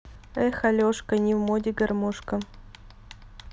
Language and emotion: Russian, neutral